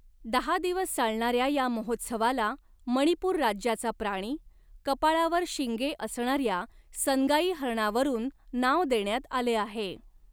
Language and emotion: Marathi, neutral